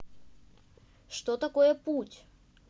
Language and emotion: Russian, neutral